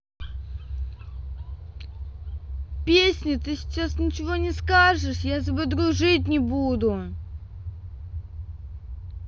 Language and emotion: Russian, neutral